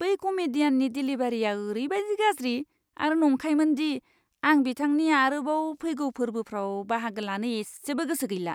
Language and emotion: Bodo, disgusted